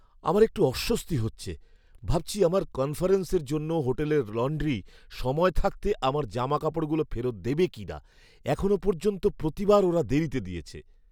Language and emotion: Bengali, fearful